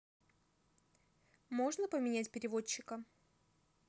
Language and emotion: Russian, neutral